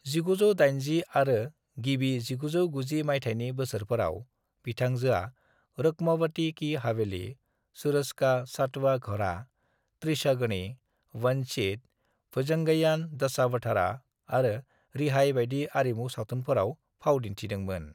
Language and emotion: Bodo, neutral